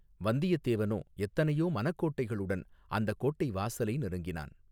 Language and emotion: Tamil, neutral